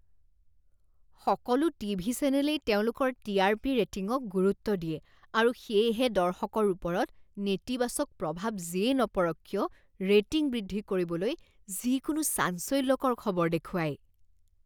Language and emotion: Assamese, disgusted